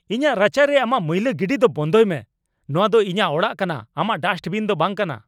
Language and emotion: Santali, angry